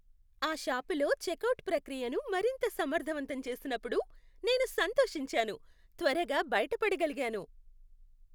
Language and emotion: Telugu, happy